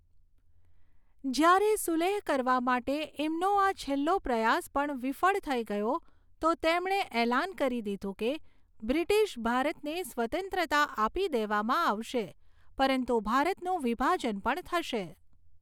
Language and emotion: Gujarati, neutral